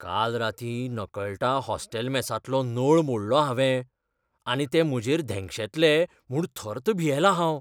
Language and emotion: Goan Konkani, fearful